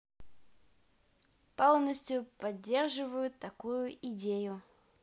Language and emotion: Russian, positive